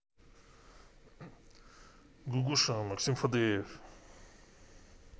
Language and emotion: Russian, neutral